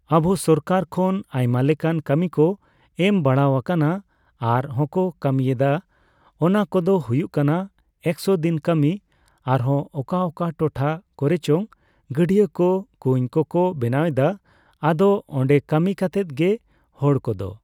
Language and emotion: Santali, neutral